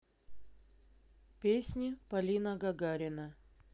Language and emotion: Russian, neutral